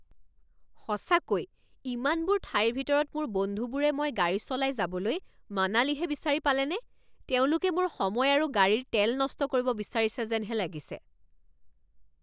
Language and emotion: Assamese, angry